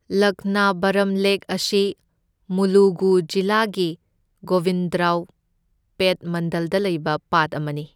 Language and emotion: Manipuri, neutral